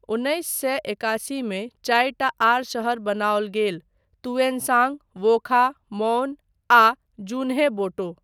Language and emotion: Maithili, neutral